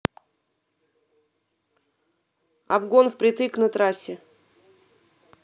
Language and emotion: Russian, neutral